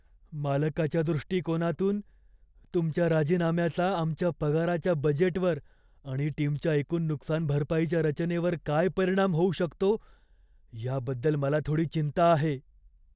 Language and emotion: Marathi, fearful